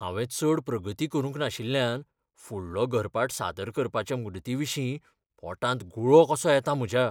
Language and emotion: Goan Konkani, fearful